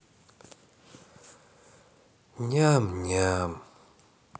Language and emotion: Russian, sad